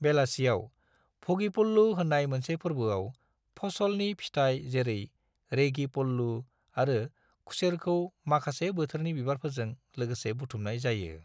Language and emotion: Bodo, neutral